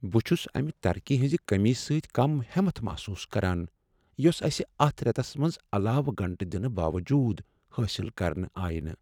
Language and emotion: Kashmiri, sad